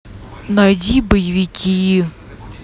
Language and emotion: Russian, angry